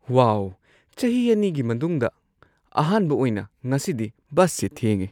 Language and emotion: Manipuri, surprised